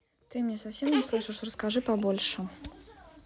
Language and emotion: Russian, neutral